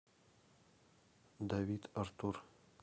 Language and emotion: Russian, neutral